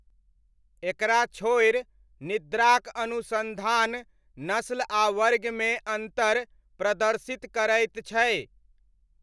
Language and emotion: Maithili, neutral